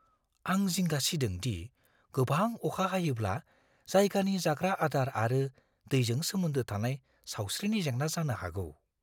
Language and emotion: Bodo, fearful